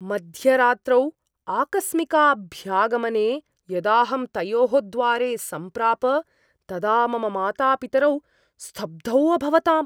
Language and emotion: Sanskrit, surprised